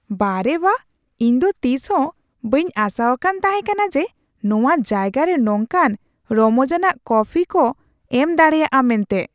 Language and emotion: Santali, surprised